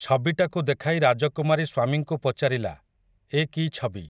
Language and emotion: Odia, neutral